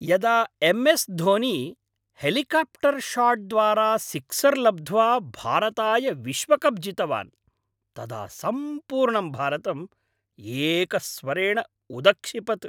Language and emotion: Sanskrit, happy